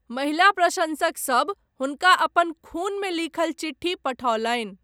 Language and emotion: Maithili, neutral